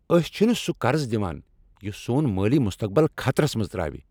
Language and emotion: Kashmiri, angry